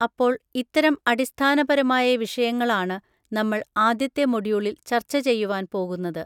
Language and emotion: Malayalam, neutral